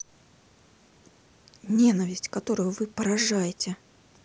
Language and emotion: Russian, angry